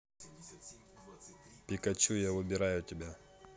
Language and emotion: Russian, neutral